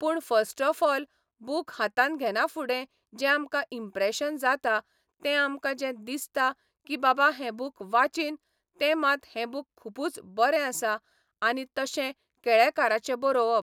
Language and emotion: Goan Konkani, neutral